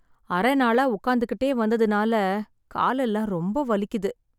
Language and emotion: Tamil, sad